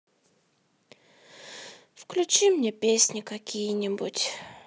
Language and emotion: Russian, sad